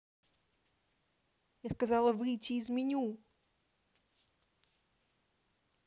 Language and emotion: Russian, angry